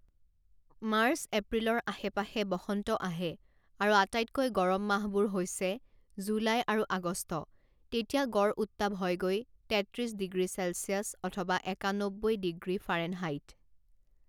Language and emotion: Assamese, neutral